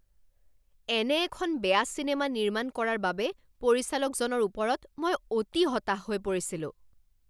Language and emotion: Assamese, angry